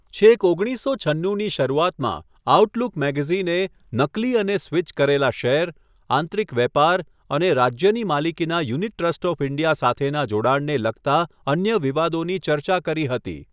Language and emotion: Gujarati, neutral